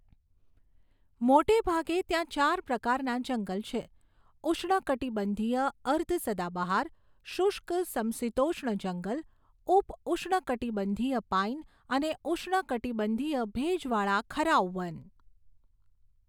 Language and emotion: Gujarati, neutral